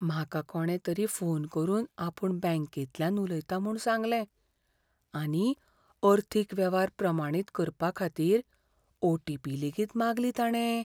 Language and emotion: Goan Konkani, fearful